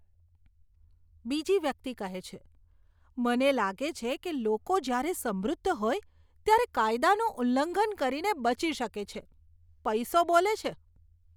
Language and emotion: Gujarati, disgusted